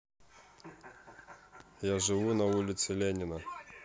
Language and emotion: Russian, neutral